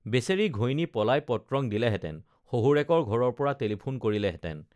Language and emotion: Assamese, neutral